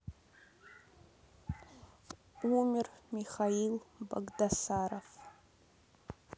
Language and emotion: Russian, sad